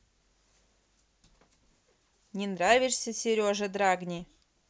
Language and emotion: Russian, neutral